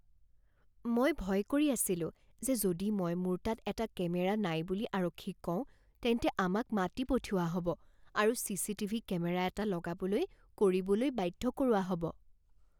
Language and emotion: Assamese, fearful